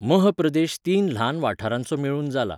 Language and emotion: Goan Konkani, neutral